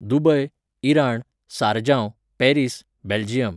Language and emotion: Goan Konkani, neutral